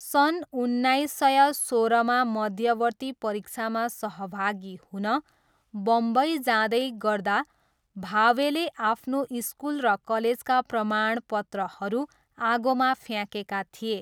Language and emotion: Nepali, neutral